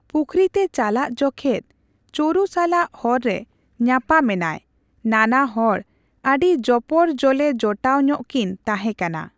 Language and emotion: Santali, neutral